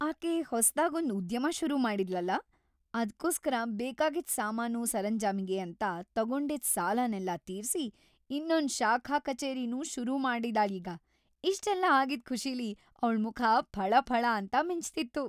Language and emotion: Kannada, happy